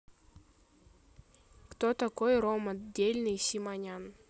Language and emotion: Russian, neutral